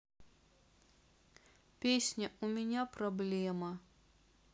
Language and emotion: Russian, sad